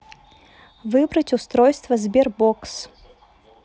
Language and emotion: Russian, neutral